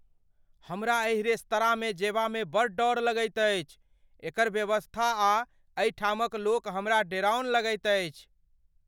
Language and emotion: Maithili, fearful